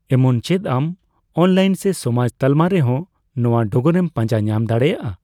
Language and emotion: Santali, neutral